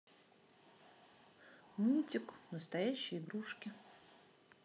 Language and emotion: Russian, sad